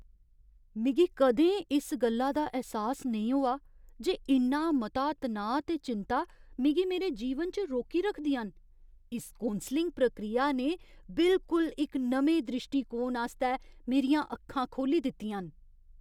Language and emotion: Dogri, surprised